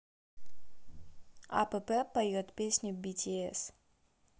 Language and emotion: Russian, neutral